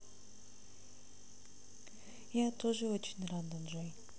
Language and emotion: Russian, sad